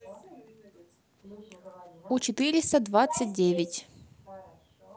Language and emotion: Russian, neutral